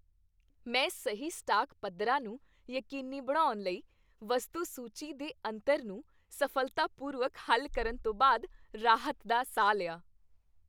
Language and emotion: Punjabi, happy